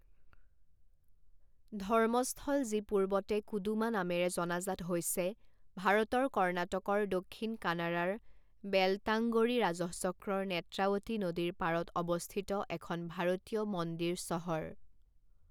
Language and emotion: Assamese, neutral